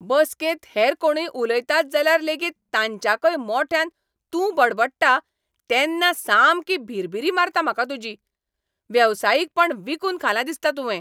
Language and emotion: Goan Konkani, angry